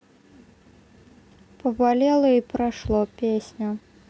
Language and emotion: Russian, neutral